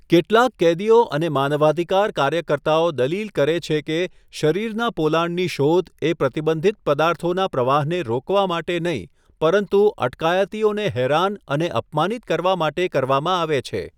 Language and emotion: Gujarati, neutral